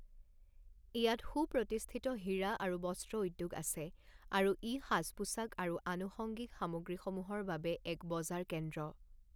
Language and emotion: Assamese, neutral